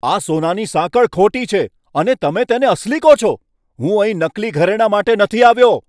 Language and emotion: Gujarati, angry